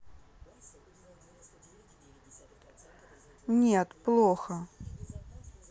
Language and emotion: Russian, sad